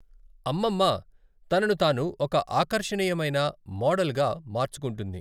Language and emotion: Telugu, neutral